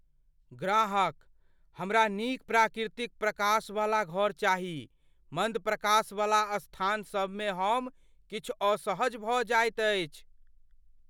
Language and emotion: Maithili, fearful